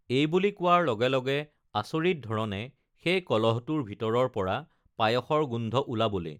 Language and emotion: Assamese, neutral